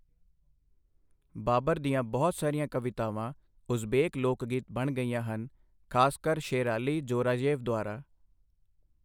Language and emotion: Punjabi, neutral